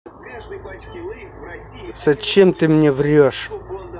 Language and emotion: Russian, angry